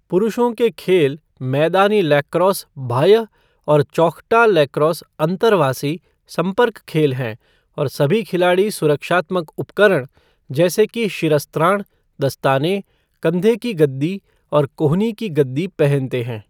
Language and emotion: Hindi, neutral